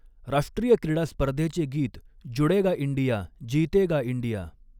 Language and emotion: Marathi, neutral